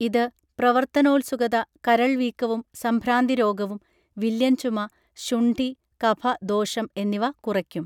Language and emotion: Malayalam, neutral